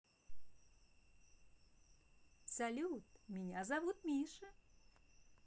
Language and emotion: Russian, positive